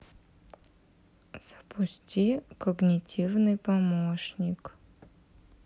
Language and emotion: Russian, neutral